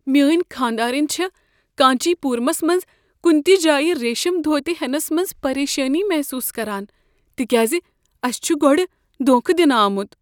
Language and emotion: Kashmiri, fearful